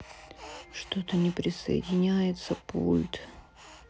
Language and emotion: Russian, sad